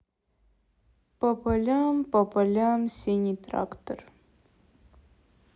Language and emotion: Russian, sad